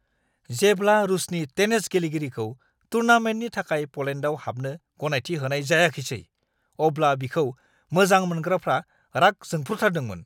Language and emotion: Bodo, angry